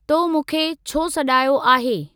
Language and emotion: Sindhi, neutral